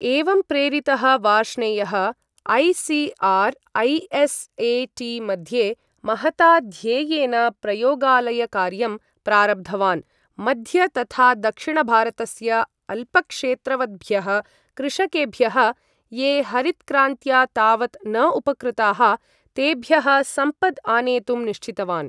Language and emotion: Sanskrit, neutral